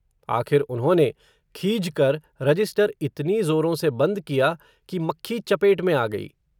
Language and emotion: Hindi, neutral